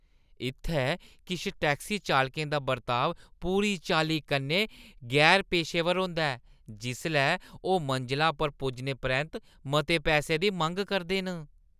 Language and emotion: Dogri, disgusted